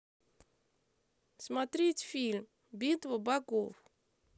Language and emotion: Russian, neutral